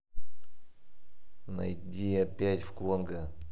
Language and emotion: Russian, angry